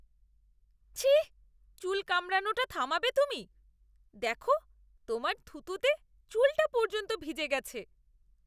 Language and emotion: Bengali, disgusted